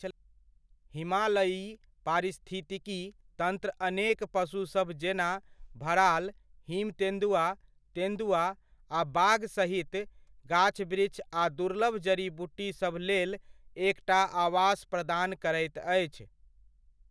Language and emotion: Maithili, neutral